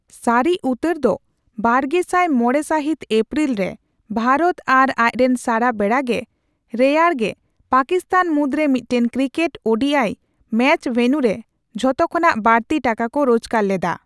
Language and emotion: Santali, neutral